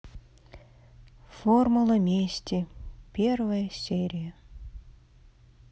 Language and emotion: Russian, sad